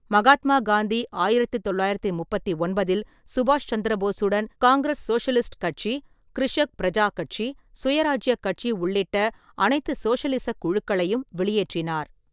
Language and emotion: Tamil, neutral